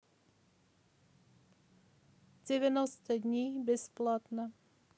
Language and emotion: Russian, neutral